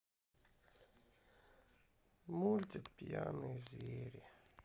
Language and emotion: Russian, sad